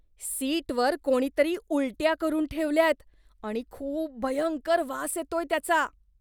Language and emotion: Marathi, disgusted